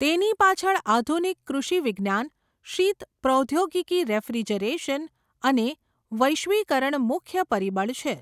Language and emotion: Gujarati, neutral